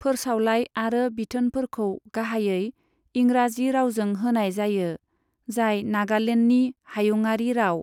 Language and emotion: Bodo, neutral